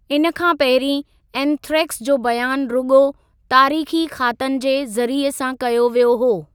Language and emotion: Sindhi, neutral